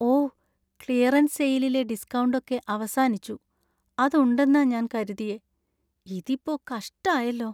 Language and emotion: Malayalam, sad